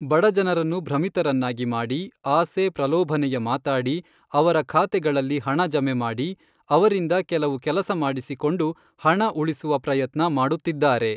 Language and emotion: Kannada, neutral